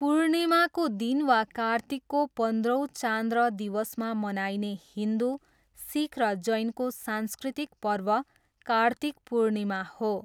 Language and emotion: Nepali, neutral